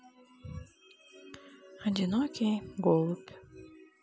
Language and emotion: Russian, sad